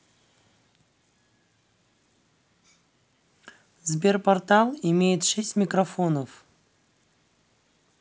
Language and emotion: Russian, neutral